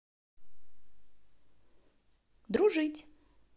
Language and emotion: Russian, neutral